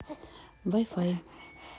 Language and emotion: Russian, neutral